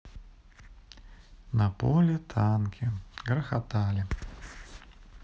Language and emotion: Russian, sad